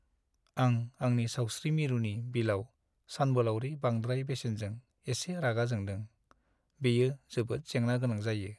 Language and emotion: Bodo, sad